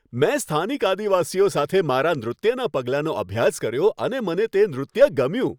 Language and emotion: Gujarati, happy